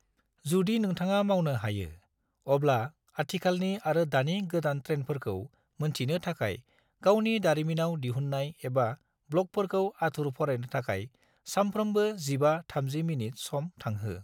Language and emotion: Bodo, neutral